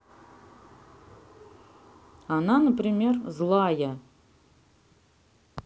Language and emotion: Russian, neutral